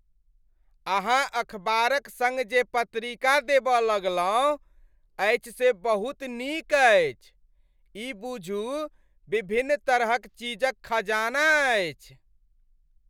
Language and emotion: Maithili, happy